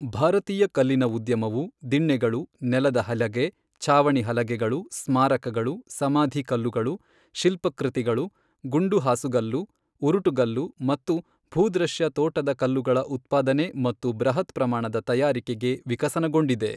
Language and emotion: Kannada, neutral